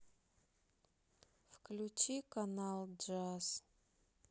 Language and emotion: Russian, sad